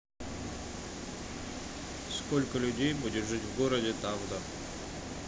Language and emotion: Russian, neutral